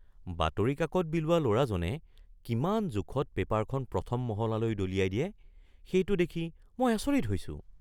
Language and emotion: Assamese, surprised